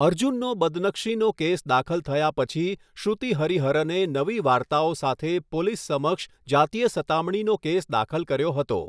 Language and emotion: Gujarati, neutral